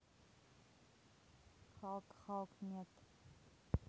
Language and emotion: Russian, neutral